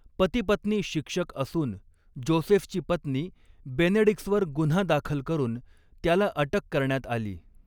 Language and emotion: Marathi, neutral